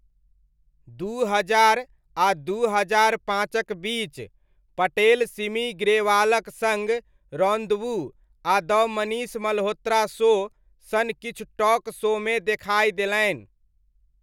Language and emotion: Maithili, neutral